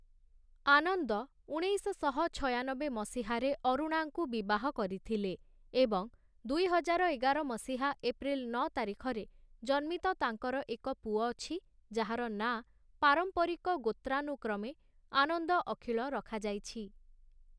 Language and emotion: Odia, neutral